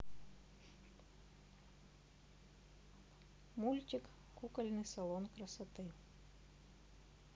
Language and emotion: Russian, neutral